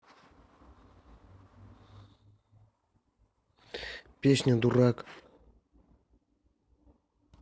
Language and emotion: Russian, neutral